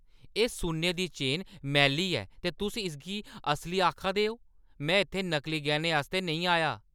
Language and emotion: Dogri, angry